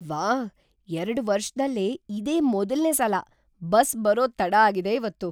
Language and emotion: Kannada, surprised